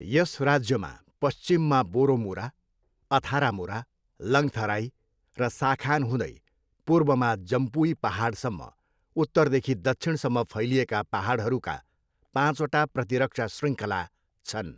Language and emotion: Nepali, neutral